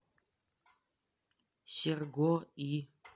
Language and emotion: Russian, neutral